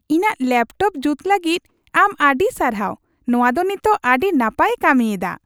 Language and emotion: Santali, happy